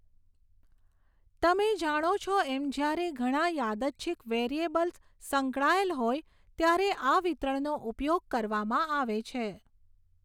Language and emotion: Gujarati, neutral